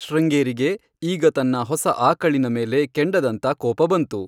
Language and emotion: Kannada, neutral